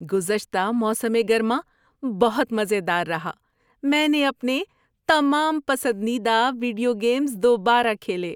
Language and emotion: Urdu, happy